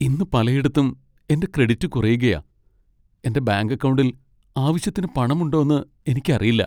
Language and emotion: Malayalam, sad